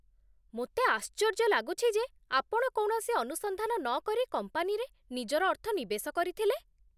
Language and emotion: Odia, surprised